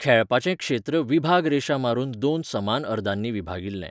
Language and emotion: Goan Konkani, neutral